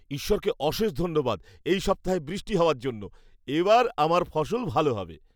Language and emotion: Bengali, happy